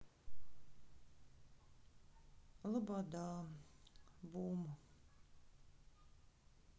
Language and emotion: Russian, sad